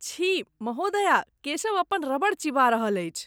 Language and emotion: Maithili, disgusted